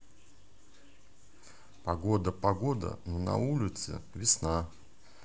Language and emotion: Russian, neutral